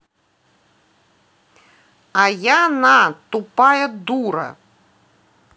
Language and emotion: Russian, angry